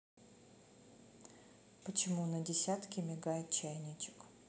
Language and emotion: Russian, neutral